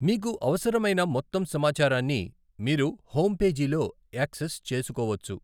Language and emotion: Telugu, neutral